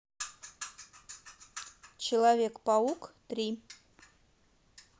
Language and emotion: Russian, neutral